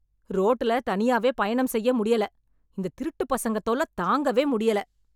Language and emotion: Tamil, angry